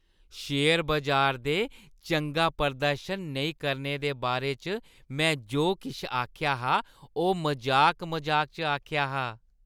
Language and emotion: Dogri, happy